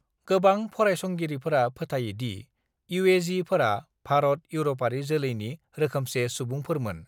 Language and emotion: Bodo, neutral